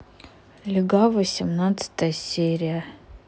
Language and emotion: Russian, neutral